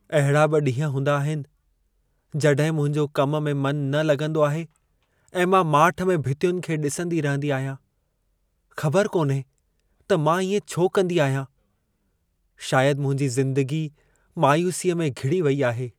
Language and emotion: Sindhi, sad